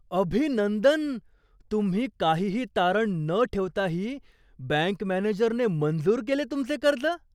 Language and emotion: Marathi, surprised